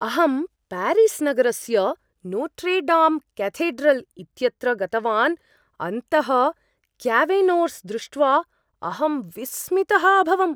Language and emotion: Sanskrit, surprised